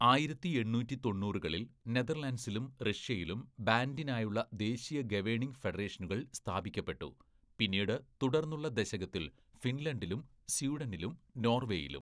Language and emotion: Malayalam, neutral